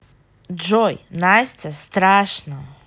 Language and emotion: Russian, neutral